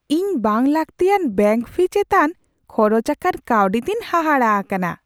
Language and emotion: Santali, surprised